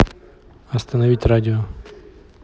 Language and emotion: Russian, neutral